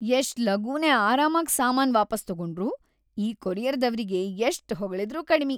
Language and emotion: Kannada, happy